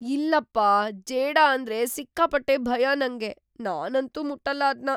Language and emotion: Kannada, fearful